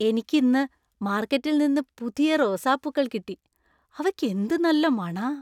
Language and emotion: Malayalam, happy